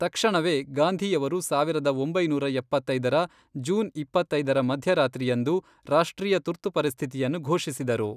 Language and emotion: Kannada, neutral